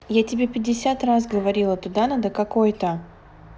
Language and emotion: Russian, neutral